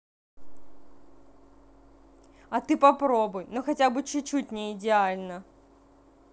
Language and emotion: Russian, angry